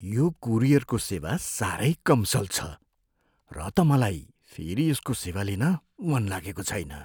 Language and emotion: Nepali, fearful